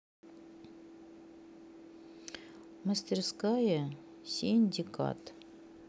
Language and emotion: Russian, neutral